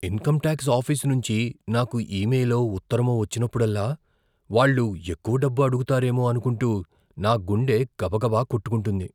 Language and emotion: Telugu, fearful